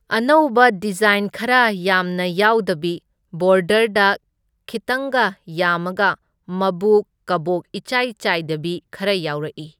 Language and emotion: Manipuri, neutral